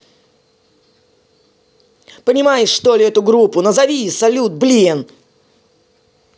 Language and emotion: Russian, angry